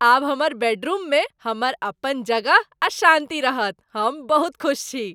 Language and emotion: Maithili, happy